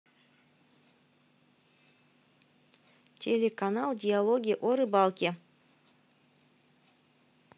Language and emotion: Russian, neutral